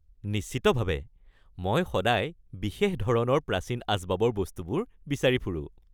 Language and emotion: Assamese, happy